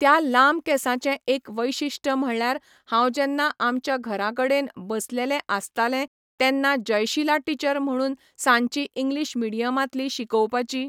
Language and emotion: Goan Konkani, neutral